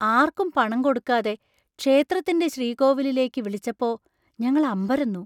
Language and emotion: Malayalam, surprised